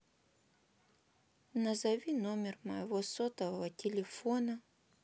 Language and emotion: Russian, sad